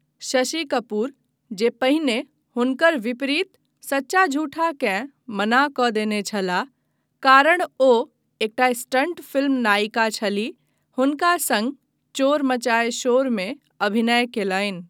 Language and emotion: Maithili, neutral